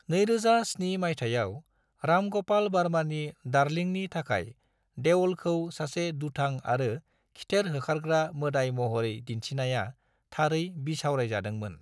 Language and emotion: Bodo, neutral